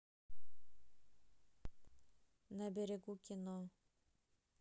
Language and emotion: Russian, neutral